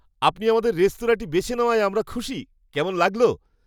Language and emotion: Bengali, happy